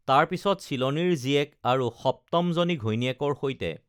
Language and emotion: Assamese, neutral